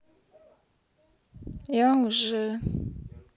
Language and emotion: Russian, neutral